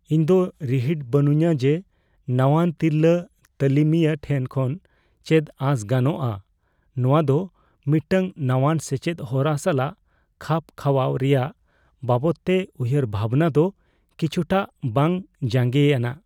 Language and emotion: Santali, fearful